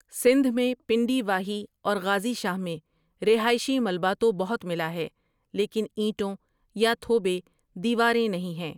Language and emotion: Urdu, neutral